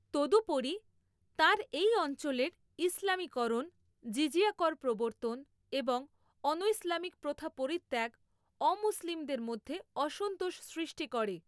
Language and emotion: Bengali, neutral